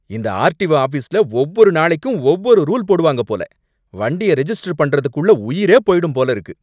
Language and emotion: Tamil, angry